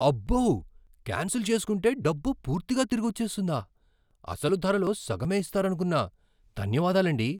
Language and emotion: Telugu, surprised